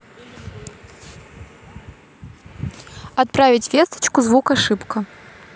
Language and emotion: Russian, neutral